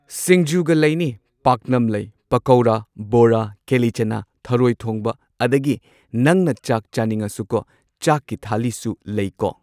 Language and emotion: Manipuri, neutral